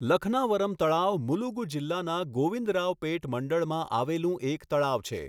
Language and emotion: Gujarati, neutral